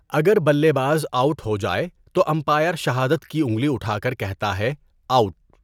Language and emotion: Urdu, neutral